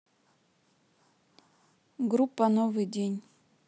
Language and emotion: Russian, neutral